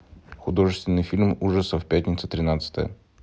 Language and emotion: Russian, neutral